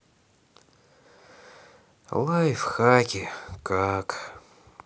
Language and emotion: Russian, sad